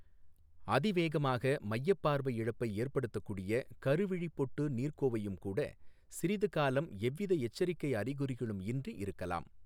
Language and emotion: Tamil, neutral